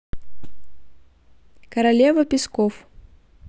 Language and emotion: Russian, neutral